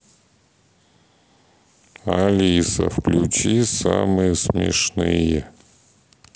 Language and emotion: Russian, sad